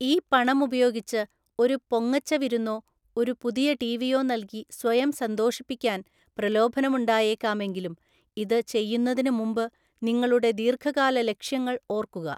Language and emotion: Malayalam, neutral